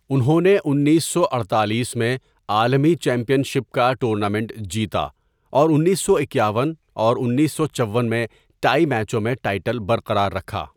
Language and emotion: Urdu, neutral